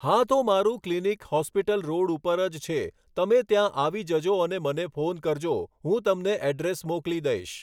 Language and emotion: Gujarati, neutral